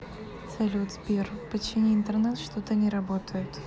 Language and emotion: Russian, neutral